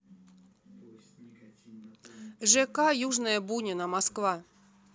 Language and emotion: Russian, neutral